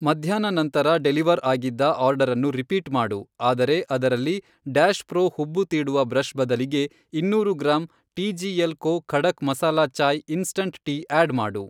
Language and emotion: Kannada, neutral